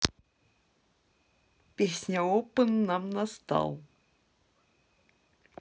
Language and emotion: Russian, positive